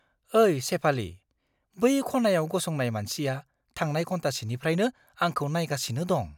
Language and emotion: Bodo, fearful